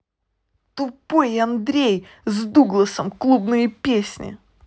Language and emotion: Russian, angry